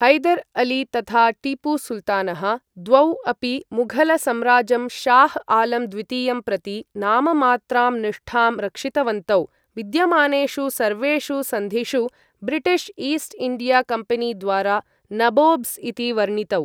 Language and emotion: Sanskrit, neutral